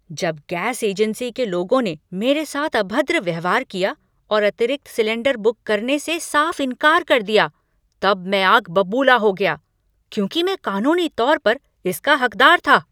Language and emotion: Hindi, angry